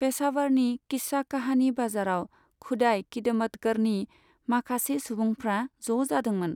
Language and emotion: Bodo, neutral